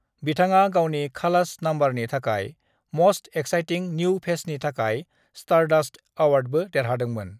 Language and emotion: Bodo, neutral